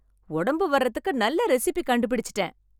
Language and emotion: Tamil, happy